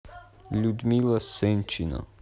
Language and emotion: Russian, neutral